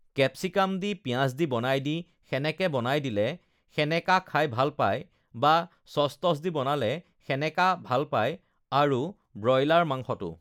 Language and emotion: Assamese, neutral